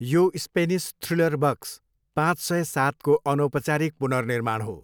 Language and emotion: Nepali, neutral